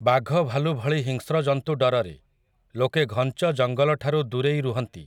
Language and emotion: Odia, neutral